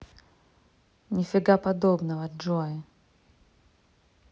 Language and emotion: Russian, neutral